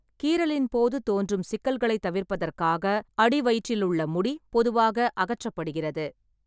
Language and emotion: Tamil, neutral